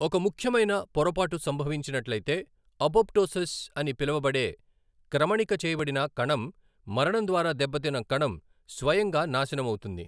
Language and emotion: Telugu, neutral